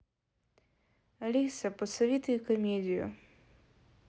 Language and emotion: Russian, neutral